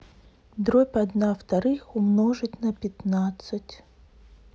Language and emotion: Russian, neutral